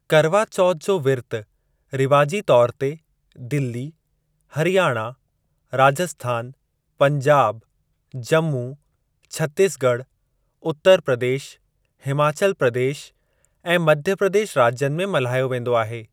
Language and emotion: Sindhi, neutral